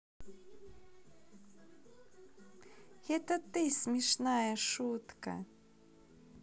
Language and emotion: Russian, positive